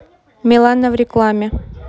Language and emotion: Russian, neutral